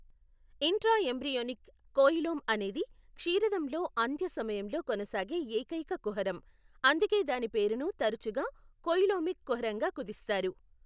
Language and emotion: Telugu, neutral